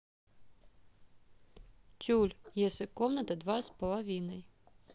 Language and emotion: Russian, neutral